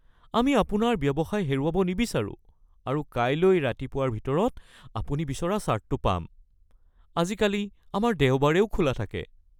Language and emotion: Assamese, fearful